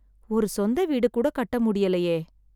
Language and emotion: Tamil, sad